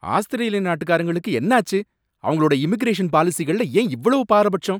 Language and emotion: Tamil, angry